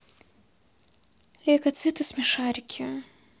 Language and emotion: Russian, sad